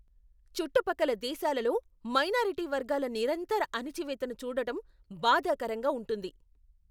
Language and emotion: Telugu, angry